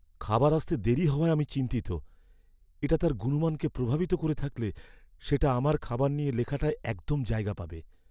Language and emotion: Bengali, fearful